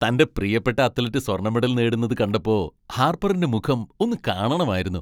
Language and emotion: Malayalam, happy